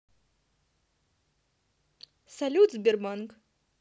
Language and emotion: Russian, positive